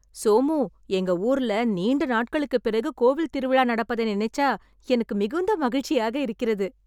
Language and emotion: Tamil, happy